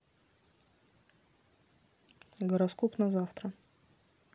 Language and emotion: Russian, neutral